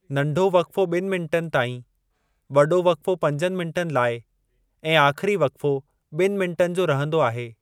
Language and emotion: Sindhi, neutral